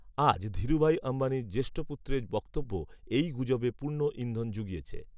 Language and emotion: Bengali, neutral